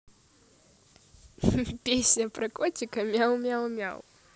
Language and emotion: Russian, positive